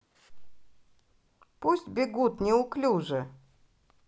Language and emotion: Russian, positive